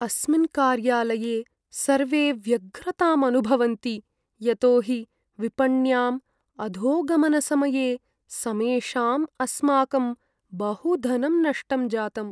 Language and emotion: Sanskrit, sad